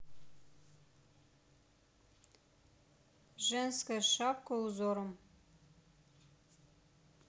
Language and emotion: Russian, neutral